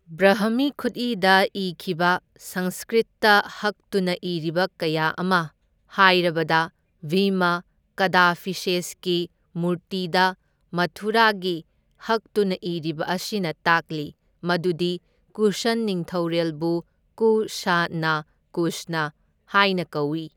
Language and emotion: Manipuri, neutral